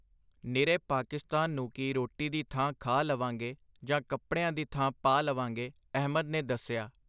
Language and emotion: Punjabi, neutral